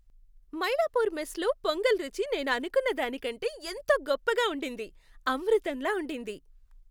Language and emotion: Telugu, happy